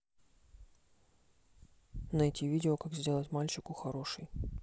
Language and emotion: Russian, neutral